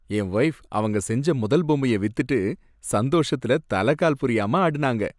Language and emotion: Tamil, happy